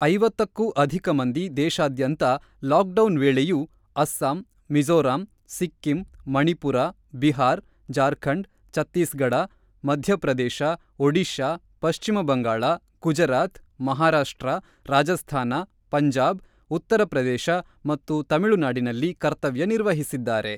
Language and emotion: Kannada, neutral